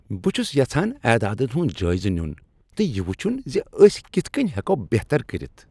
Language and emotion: Kashmiri, happy